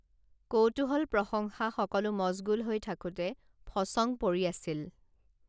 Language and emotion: Assamese, neutral